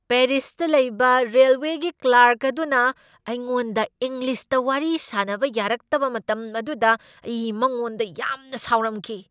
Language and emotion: Manipuri, angry